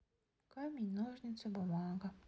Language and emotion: Russian, sad